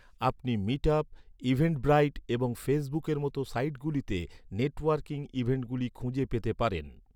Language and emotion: Bengali, neutral